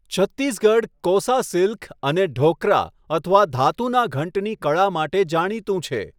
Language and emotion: Gujarati, neutral